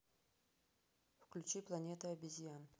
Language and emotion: Russian, neutral